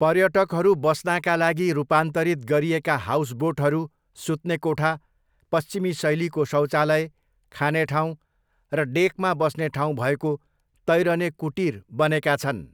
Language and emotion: Nepali, neutral